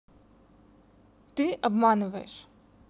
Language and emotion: Russian, neutral